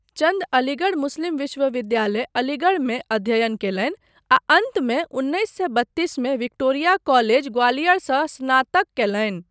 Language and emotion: Maithili, neutral